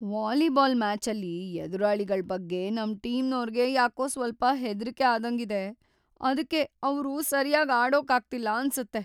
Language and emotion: Kannada, fearful